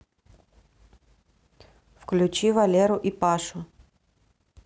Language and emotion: Russian, neutral